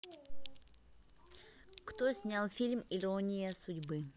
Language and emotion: Russian, neutral